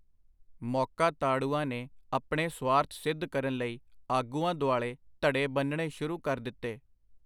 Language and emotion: Punjabi, neutral